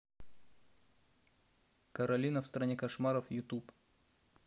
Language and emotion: Russian, neutral